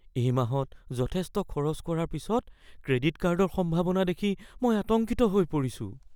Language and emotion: Assamese, fearful